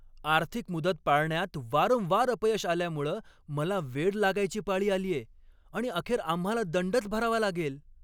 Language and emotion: Marathi, angry